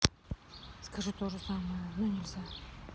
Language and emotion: Russian, neutral